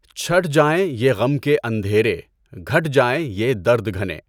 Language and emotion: Urdu, neutral